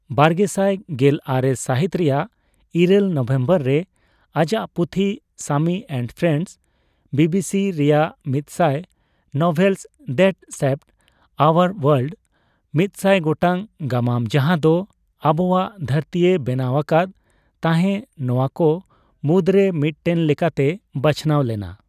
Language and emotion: Santali, neutral